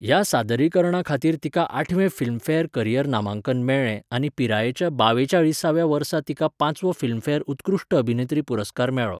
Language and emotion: Goan Konkani, neutral